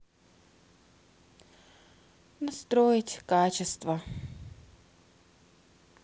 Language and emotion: Russian, sad